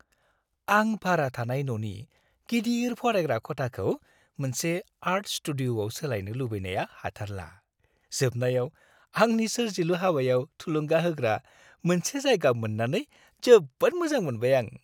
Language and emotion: Bodo, happy